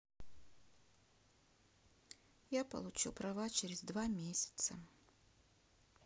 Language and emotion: Russian, sad